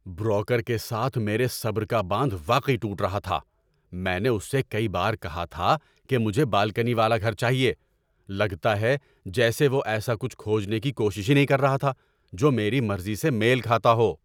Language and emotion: Urdu, angry